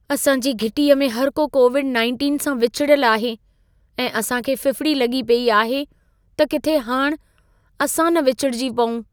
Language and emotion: Sindhi, fearful